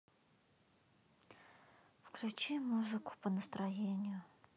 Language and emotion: Russian, sad